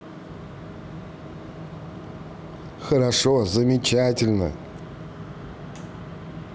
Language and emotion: Russian, positive